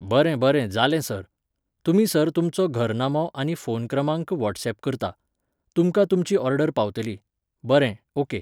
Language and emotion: Goan Konkani, neutral